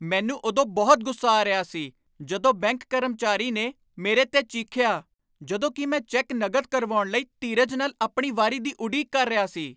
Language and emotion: Punjabi, angry